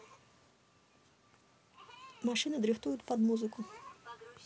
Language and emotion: Russian, neutral